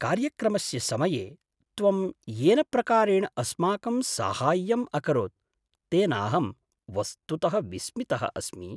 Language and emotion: Sanskrit, surprised